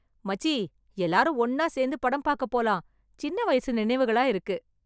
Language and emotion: Tamil, happy